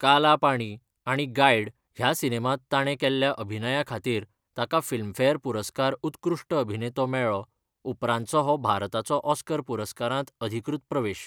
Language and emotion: Goan Konkani, neutral